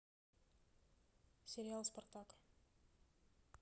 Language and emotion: Russian, neutral